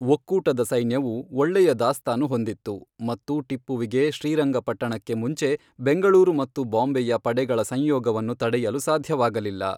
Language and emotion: Kannada, neutral